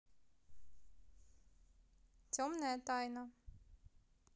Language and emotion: Russian, neutral